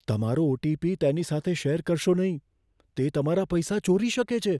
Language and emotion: Gujarati, fearful